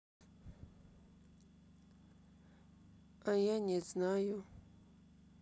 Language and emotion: Russian, sad